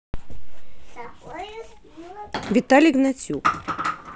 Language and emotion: Russian, neutral